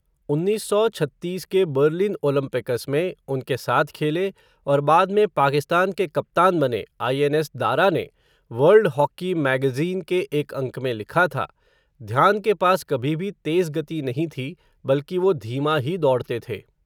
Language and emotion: Hindi, neutral